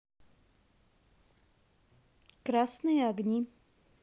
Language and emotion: Russian, neutral